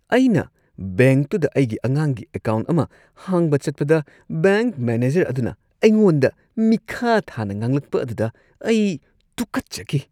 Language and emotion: Manipuri, disgusted